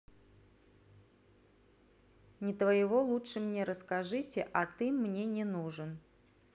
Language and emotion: Russian, neutral